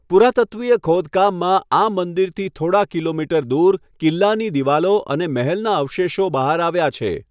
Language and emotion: Gujarati, neutral